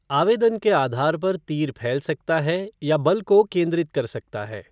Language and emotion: Hindi, neutral